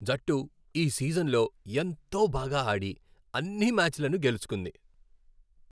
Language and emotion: Telugu, happy